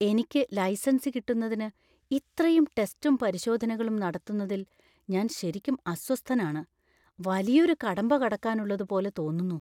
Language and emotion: Malayalam, fearful